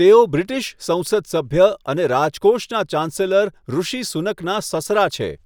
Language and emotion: Gujarati, neutral